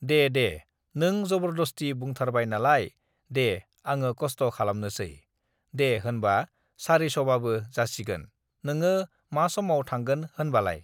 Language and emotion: Bodo, neutral